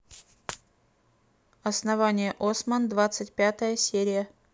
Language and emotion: Russian, neutral